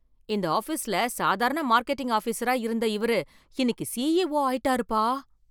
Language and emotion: Tamil, surprised